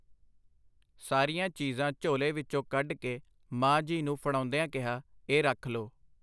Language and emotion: Punjabi, neutral